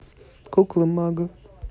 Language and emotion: Russian, neutral